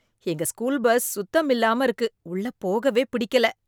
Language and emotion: Tamil, disgusted